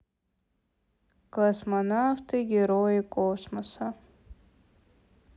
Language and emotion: Russian, sad